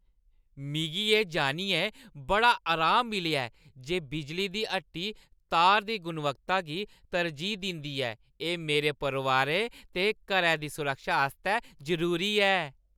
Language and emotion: Dogri, happy